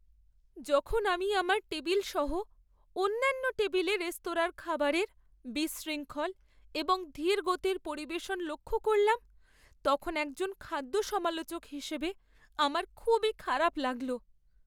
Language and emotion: Bengali, sad